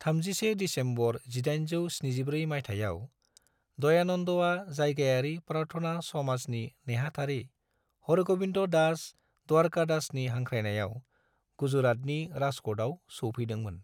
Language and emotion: Bodo, neutral